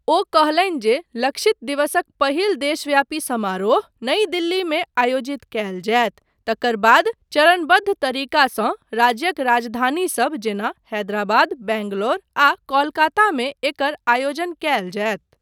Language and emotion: Maithili, neutral